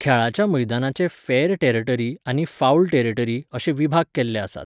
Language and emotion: Goan Konkani, neutral